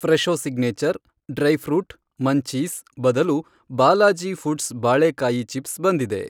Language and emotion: Kannada, neutral